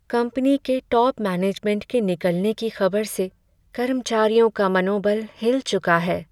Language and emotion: Hindi, sad